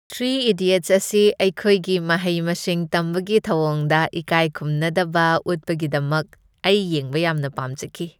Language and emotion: Manipuri, happy